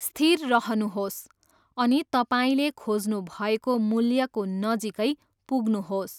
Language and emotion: Nepali, neutral